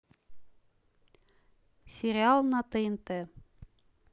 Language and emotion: Russian, neutral